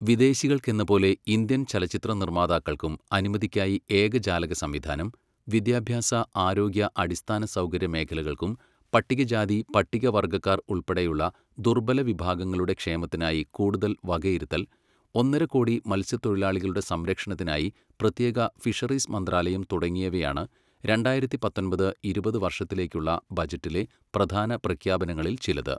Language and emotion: Malayalam, neutral